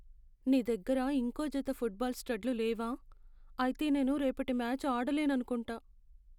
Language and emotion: Telugu, sad